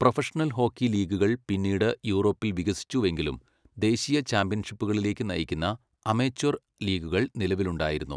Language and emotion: Malayalam, neutral